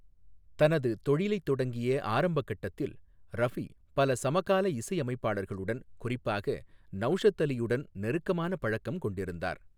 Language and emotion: Tamil, neutral